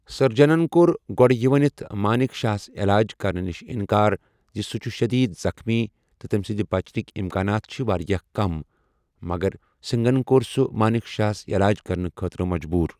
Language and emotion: Kashmiri, neutral